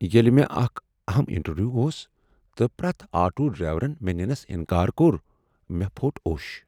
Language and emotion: Kashmiri, sad